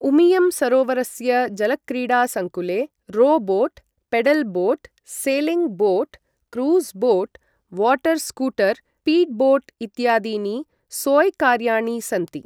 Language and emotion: Sanskrit, neutral